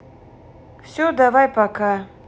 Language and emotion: Russian, neutral